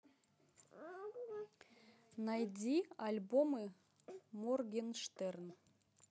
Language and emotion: Russian, neutral